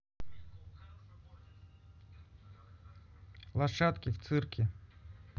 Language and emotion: Russian, neutral